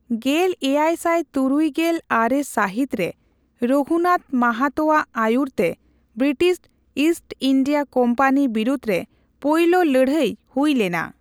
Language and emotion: Santali, neutral